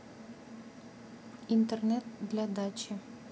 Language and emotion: Russian, neutral